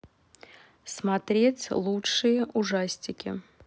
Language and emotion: Russian, neutral